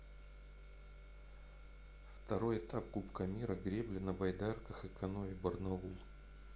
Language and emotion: Russian, neutral